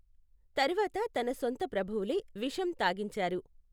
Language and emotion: Telugu, neutral